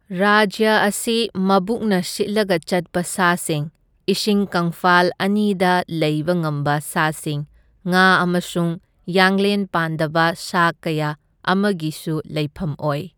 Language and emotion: Manipuri, neutral